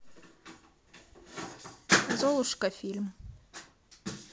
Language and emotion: Russian, neutral